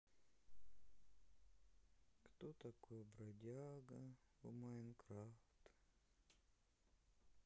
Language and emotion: Russian, sad